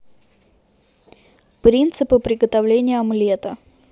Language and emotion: Russian, neutral